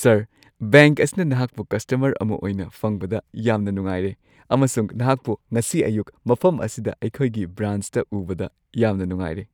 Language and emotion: Manipuri, happy